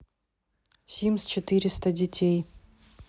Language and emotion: Russian, neutral